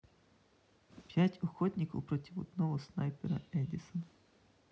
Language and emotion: Russian, neutral